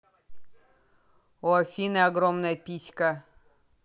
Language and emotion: Russian, neutral